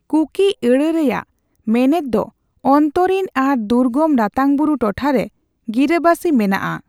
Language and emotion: Santali, neutral